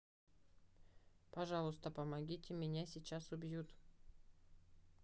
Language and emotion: Russian, neutral